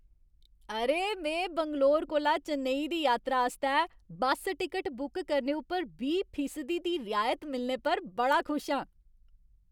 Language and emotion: Dogri, happy